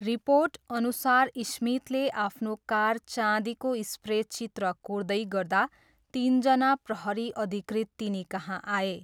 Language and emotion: Nepali, neutral